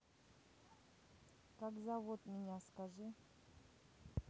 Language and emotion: Russian, neutral